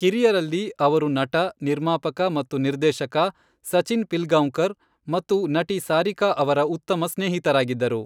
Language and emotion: Kannada, neutral